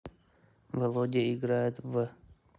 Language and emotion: Russian, neutral